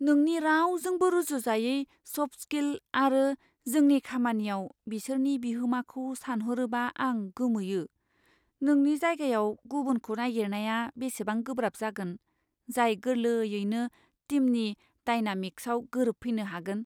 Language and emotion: Bodo, fearful